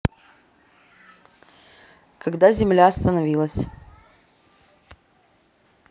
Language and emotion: Russian, neutral